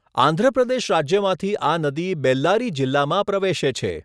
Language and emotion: Gujarati, neutral